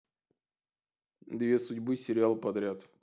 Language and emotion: Russian, neutral